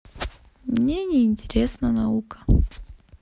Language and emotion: Russian, sad